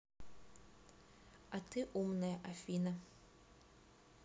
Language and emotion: Russian, neutral